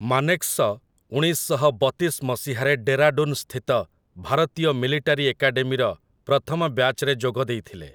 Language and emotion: Odia, neutral